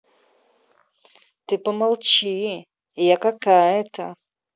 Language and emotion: Russian, angry